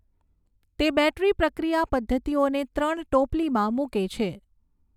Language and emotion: Gujarati, neutral